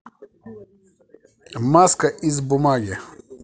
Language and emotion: Russian, positive